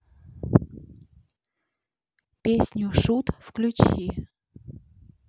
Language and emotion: Russian, neutral